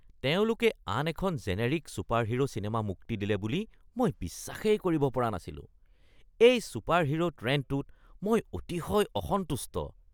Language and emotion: Assamese, disgusted